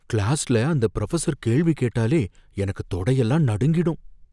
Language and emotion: Tamil, fearful